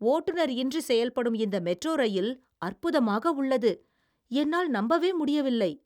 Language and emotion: Tamil, surprised